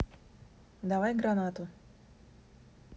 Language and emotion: Russian, neutral